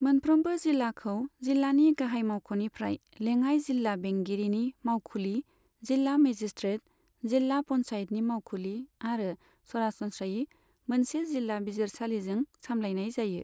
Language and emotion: Bodo, neutral